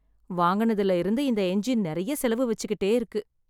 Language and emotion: Tamil, sad